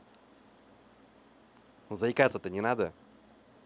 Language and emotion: Russian, neutral